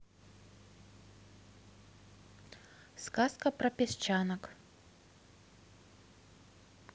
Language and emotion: Russian, neutral